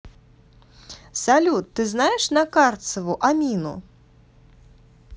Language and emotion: Russian, positive